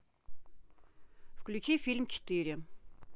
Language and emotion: Russian, neutral